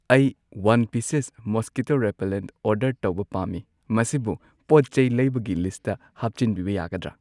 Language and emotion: Manipuri, neutral